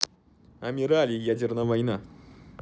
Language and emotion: Russian, neutral